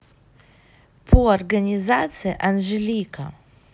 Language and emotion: Russian, neutral